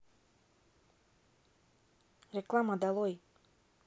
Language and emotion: Russian, neutral